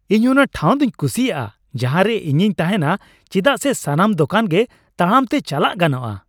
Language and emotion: Santali, happy